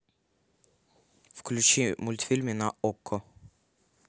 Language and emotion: Russian, neutral